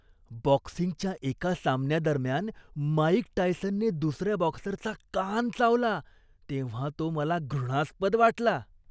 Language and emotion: Marathi, disgusted